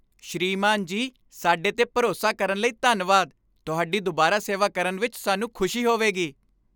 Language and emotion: Punjabi, happy